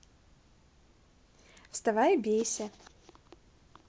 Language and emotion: Russian, neutral